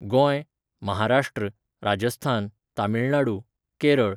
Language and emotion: Goan Konkani, neutral